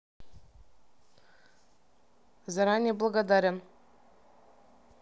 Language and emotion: Russian, neutral